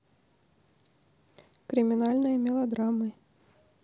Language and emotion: Russian, neutral